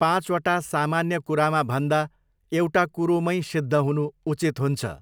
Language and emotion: Nepali, neutral